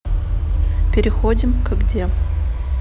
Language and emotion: Russian, neutral